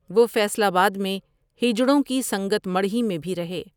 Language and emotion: Urdu, neutral